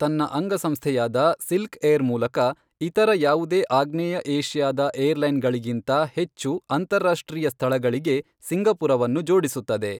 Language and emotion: Kannada, neutral